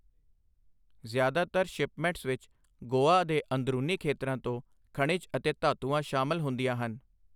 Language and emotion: Punjabi, neutral